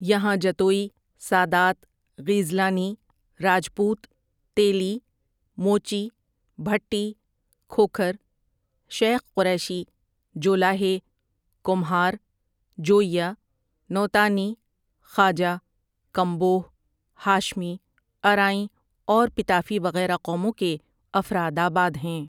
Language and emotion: Urdu, neutral